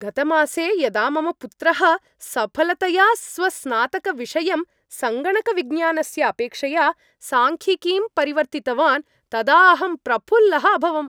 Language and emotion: Sanskrit, happy